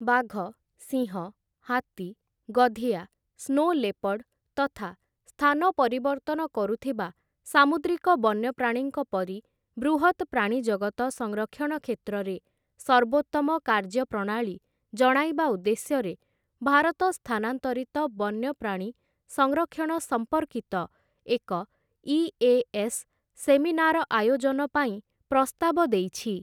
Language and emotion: Odia, neutral